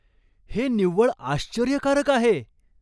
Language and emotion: Marathi, surprised